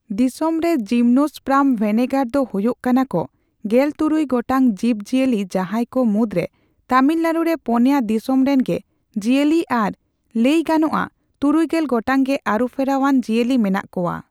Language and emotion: Santali, neutral